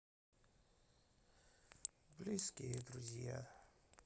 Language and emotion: Russian, sad